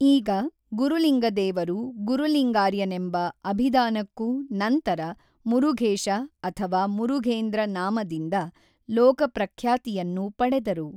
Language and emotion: Kannada, neutral